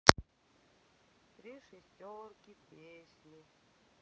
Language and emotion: Russian, sad